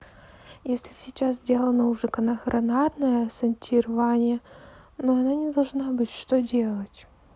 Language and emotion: Russian, neutral